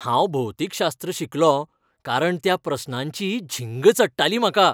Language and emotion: Goan Konkani, happy